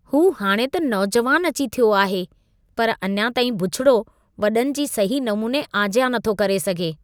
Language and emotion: Sindhi, disgusted